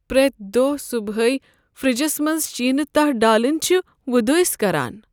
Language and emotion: Kashmiri, sad